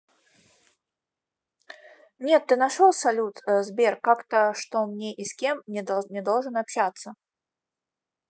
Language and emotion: Russian, neutral